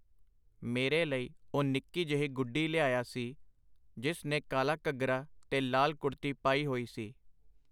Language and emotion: Punjabi, neutral